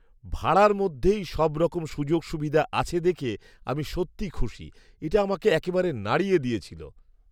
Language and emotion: Bengali, surprised